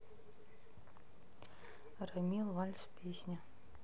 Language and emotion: Russian, neutral